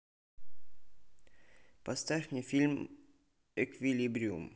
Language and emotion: Russian, neutral